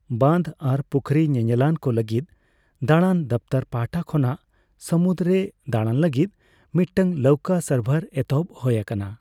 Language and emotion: Santali, neutral